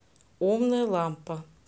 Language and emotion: Russian, neutral